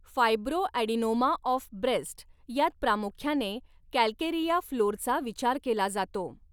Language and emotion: Marathi, neutral